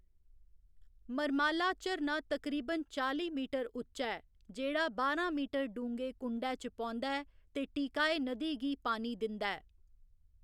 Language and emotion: Dogri, neutral